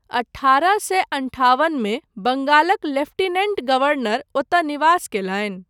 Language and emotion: Maithili, neutral